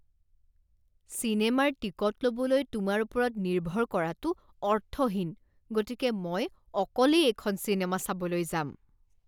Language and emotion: Assamese, disgusted